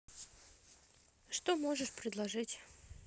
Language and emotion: Russian, neutral